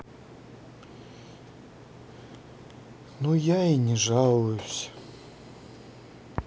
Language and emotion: Russian, sad